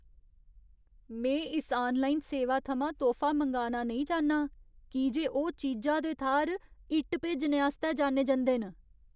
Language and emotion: Dogri, fearful